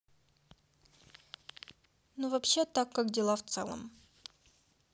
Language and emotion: Russian, neutral